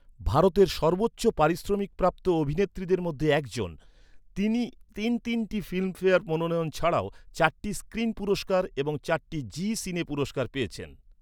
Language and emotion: Bengali, neutral